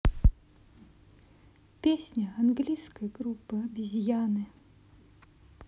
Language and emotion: Russian, sad